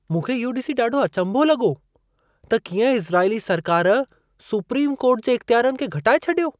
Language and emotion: Sindhi, surprised